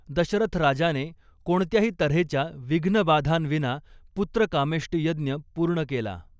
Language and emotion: Marathi, neutral